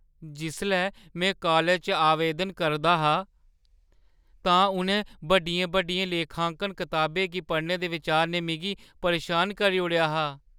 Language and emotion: Dogri, fearful